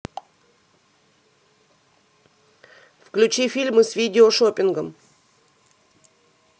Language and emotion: Russian, neutral